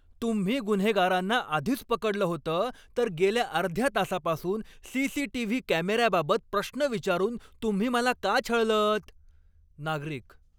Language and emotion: Marathi, angry